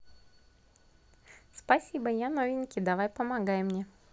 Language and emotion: Russian, positive